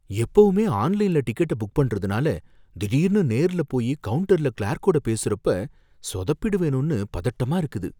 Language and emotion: Tamil, fearful